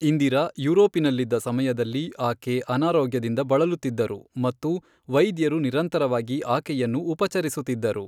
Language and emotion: Kannada, neutral